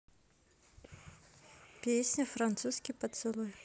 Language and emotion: Russian, neutral